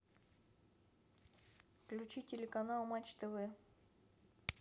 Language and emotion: Russian, neutral